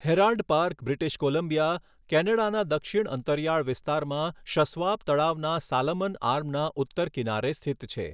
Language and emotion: Gujarati, neutral